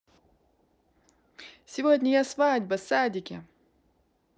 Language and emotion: Russian, positive